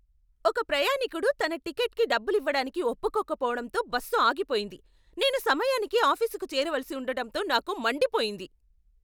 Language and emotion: Telugu, angry